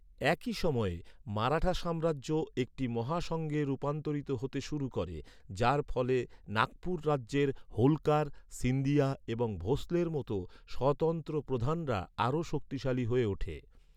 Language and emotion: Bengali, neutral